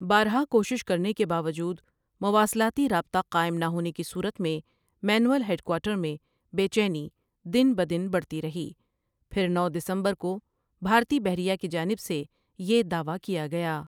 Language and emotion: Urdu, neutral